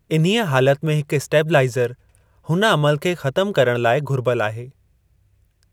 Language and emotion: Sindhi, neutral